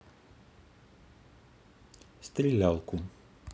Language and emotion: Russian, neutral